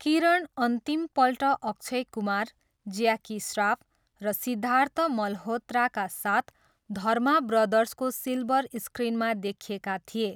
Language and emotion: Nepali, neutral